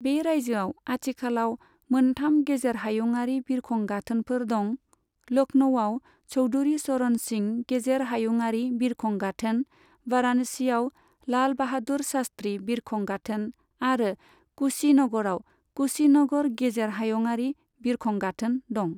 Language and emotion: Bodo, neutral